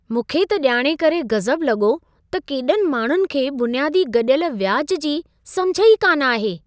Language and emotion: Sindhi, surprised